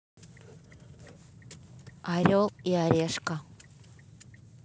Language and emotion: Russian, neutral